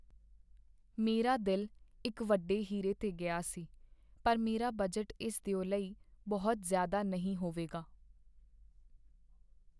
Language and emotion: Punjabi, sad